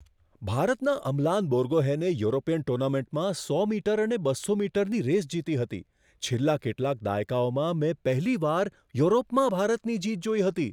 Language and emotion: Gujarati, surprised